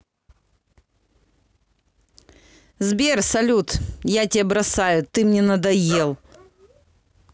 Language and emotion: Russian, angry